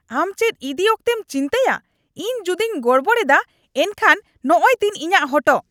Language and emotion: Santali, angry